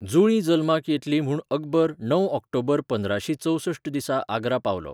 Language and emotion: Goan Konkani, neutral